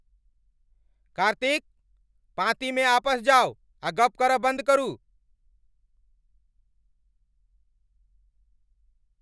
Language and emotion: Maithili, angry